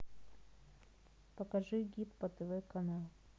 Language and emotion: Russian, neutral